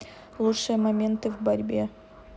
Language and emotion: Russian, neutral